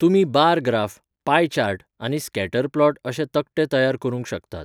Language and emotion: Goan Konkani, neutral